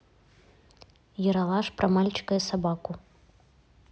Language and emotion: Russian, neutral